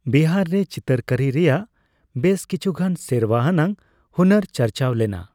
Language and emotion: Santali, neutral